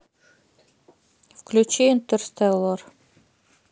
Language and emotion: Russian, neutral